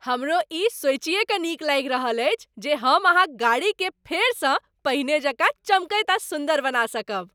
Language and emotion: Maithili, happy